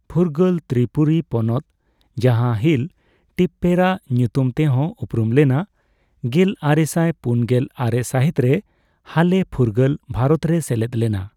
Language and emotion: Santali, neutral